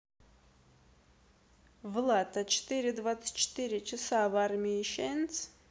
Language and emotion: Russian, neutral